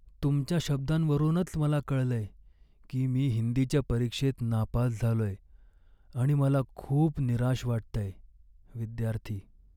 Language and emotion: Marathi, sad